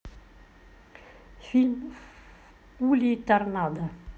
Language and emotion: Russian, neutral